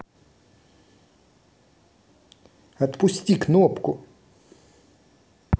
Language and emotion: Russian, angry